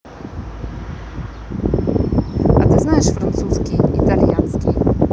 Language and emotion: Russian, neutral